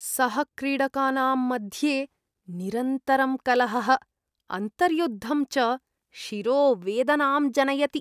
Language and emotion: Sanskrit, disgusted